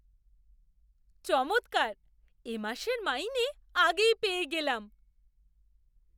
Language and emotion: Bengali, surprised